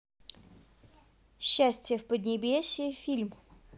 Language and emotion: Russian, neutral